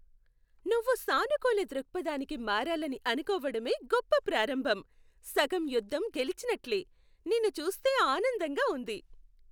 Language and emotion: Telugu, happy